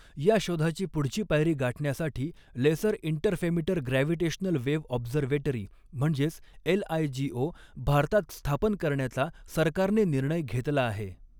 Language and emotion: Marathi, neutral